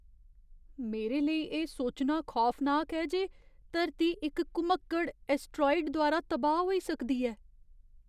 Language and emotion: Dogri, fearful